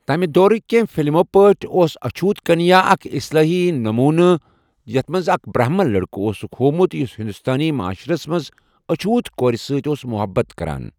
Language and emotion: Kashmiri, neutral